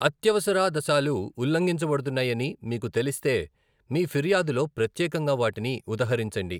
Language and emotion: Telugu, neutral